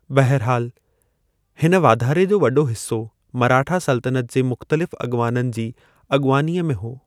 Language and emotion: Sindhi, neutral